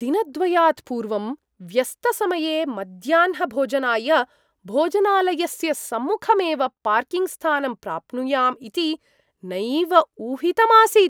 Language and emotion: Sanskrit, surprised